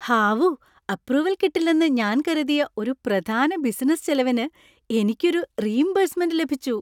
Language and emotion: Malayalam, happy